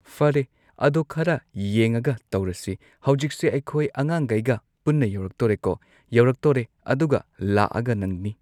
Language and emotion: Manipuri, neutral